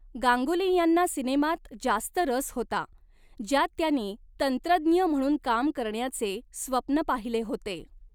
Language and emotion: Marathi, neutral